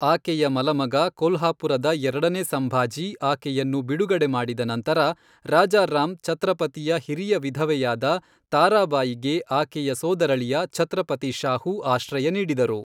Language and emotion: Kannada, neutral